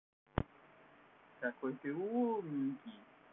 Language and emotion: Russian, positive